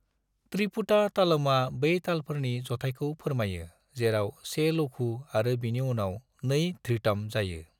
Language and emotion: Bodo, neutral